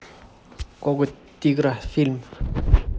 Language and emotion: Russian, neutral